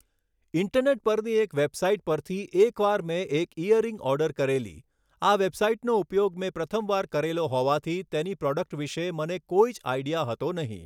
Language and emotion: Gujarati, neutral